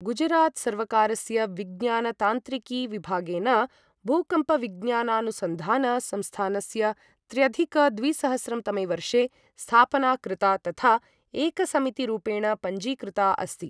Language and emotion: Sanskrit, neutral